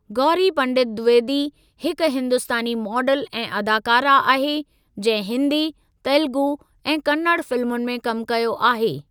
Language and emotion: Sindhi, neutral